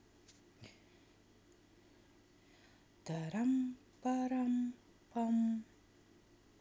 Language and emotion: Russian, neutral